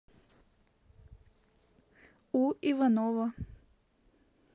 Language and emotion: Russian, neutral